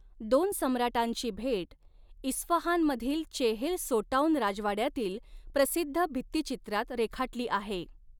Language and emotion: Marathi, neutral